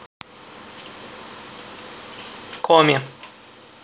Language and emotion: Russian, neutral